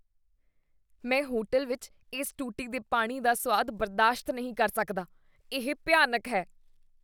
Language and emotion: Punjabi, disgusted